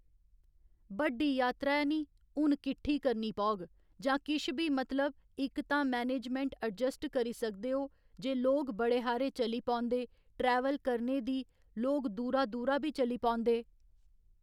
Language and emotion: Dogri, neutral